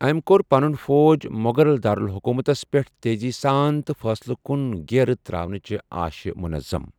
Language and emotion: Kashmiri, neutral